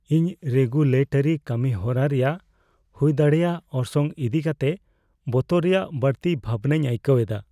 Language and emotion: Santali, fearful